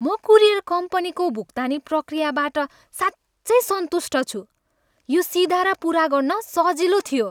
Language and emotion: Nepali, happy